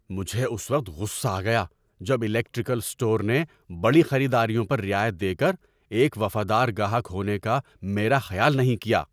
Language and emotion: Urdu, angry